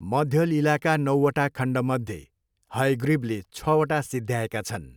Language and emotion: Nepali, neutral